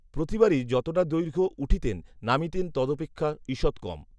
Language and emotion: Bengali, neutral